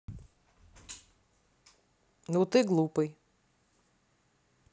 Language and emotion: Russian, neutral